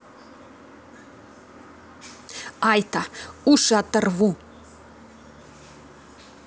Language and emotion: Russian, angry